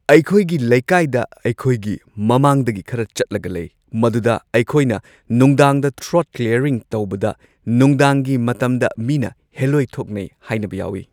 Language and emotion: Manipuri, neutral